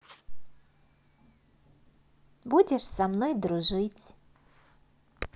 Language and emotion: Russian, positive